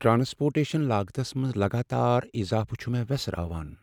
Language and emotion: Kashmiri, sad